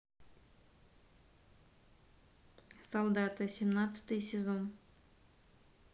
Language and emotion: Russian, neutral